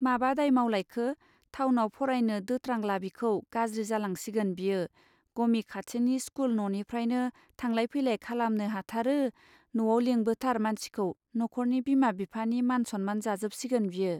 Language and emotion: Bodo, neutral